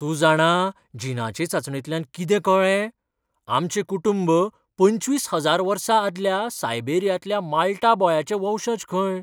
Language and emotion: Goan Konkani, surprised